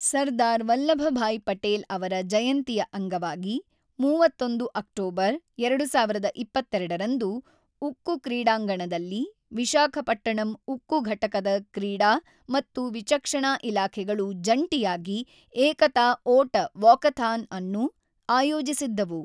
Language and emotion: Kannada, neutral